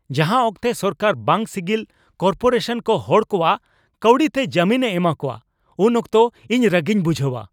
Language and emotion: Santali, angry